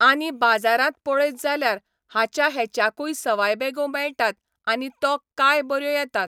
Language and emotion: Goan Konkani, neutral